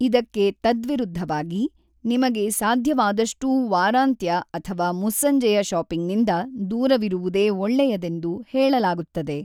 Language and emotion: Kannada, neutral